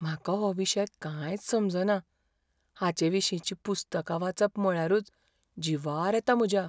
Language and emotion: Goan Konkani, fearful